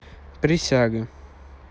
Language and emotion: Russian, neutral